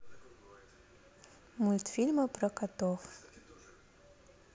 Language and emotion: Russian, neutral